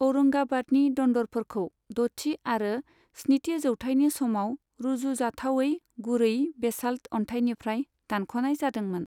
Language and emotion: Bodo, neutral